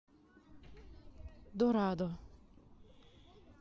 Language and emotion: Russian, neutral